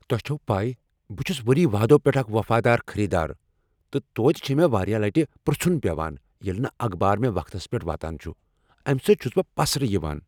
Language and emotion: Kashmiri, angry